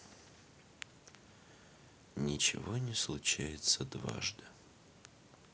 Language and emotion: Russian, neutral